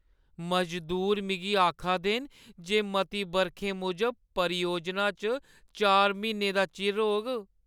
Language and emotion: Dogri, sad